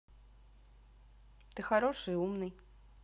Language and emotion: Russian, neutral